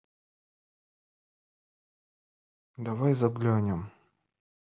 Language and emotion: Russian, neutral